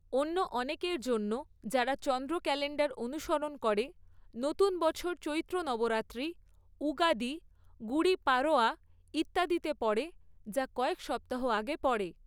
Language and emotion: Bengali, neutral